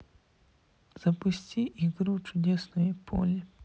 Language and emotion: Russian, sad